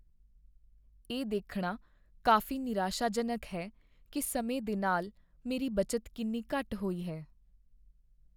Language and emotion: Punjabi, sad